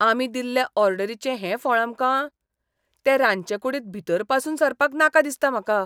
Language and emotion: Goan Konkani, disgusted